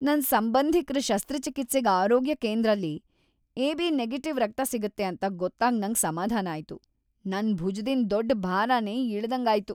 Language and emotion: Kannada, happy